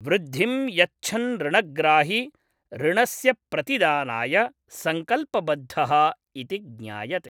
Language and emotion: Sanskrit, neutral